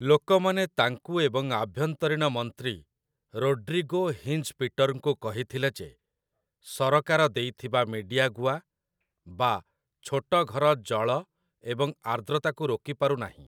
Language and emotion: Odia, neutral